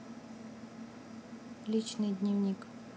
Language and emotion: Russian, neutral